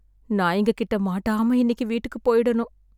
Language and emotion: Tamil, sad